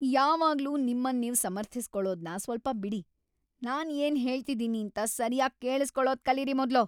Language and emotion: Kannada, angry